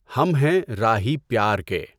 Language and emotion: Urdu, neutral